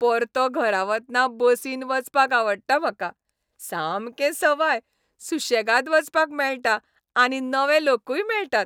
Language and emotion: Goan Konkani, happy